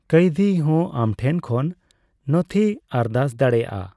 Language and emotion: Santali, neutral